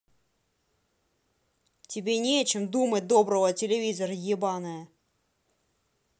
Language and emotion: Russian, angry